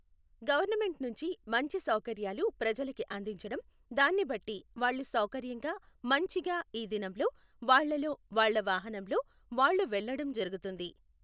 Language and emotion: Telugu, neutral